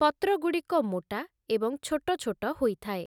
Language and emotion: Odia, neutral